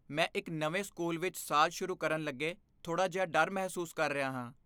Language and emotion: Punjabi, fearful